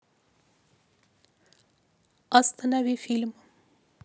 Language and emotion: Russian, neutral